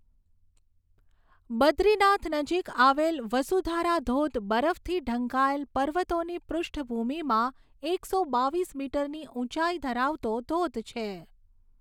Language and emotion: Gujarati, neutral